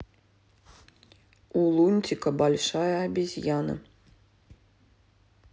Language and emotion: Russian, neutral